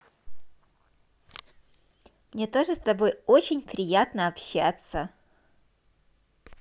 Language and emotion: Russian, positive